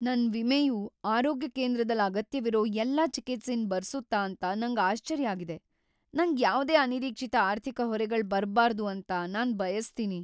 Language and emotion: Kannada, fearful